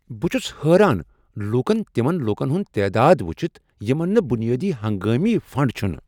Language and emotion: Kashmiri, surprised